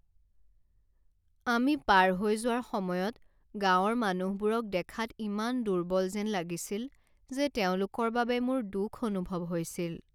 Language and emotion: Assamese, sad